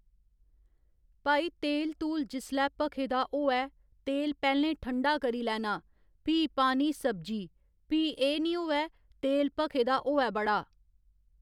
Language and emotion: Dogri, neutral